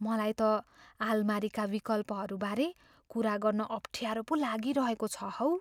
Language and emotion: Nepali, fearful